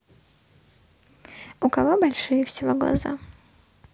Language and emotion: Russian, neutral